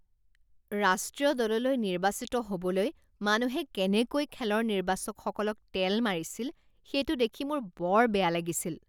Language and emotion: Assamese, disgusted